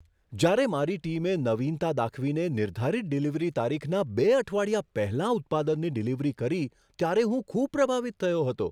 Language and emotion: Gujarati, surprised